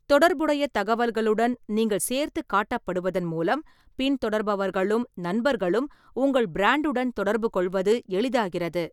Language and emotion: Tamil, neutral